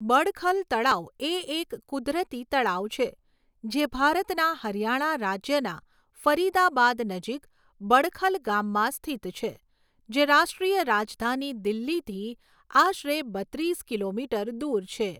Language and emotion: Gujarati, neutral